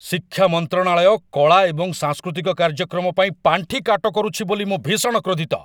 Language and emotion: Odia, angry